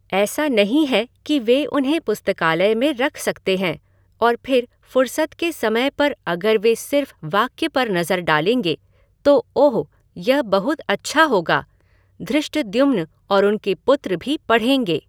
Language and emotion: Hindi, neutral